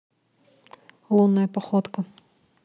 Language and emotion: Russian, neutral